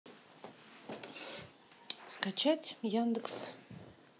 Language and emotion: Russian, neutral